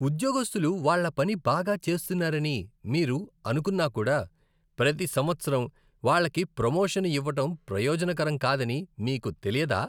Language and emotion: Telugu, disgusted